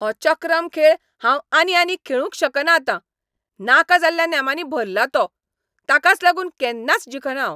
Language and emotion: Goan Konkani, angry